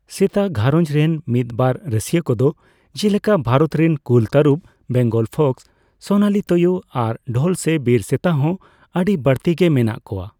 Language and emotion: Santali, neutral